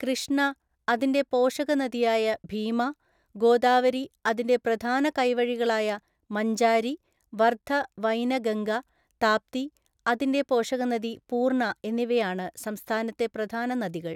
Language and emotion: Malayalam, neutral